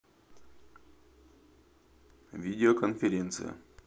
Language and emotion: Russian, neutral